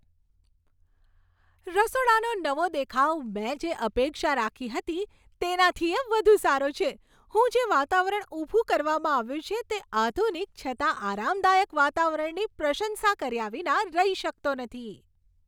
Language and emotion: Gujarati, happy